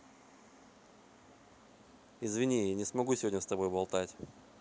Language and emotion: Russian, neutral